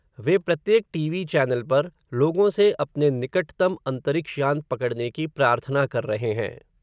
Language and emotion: Hindi, neutral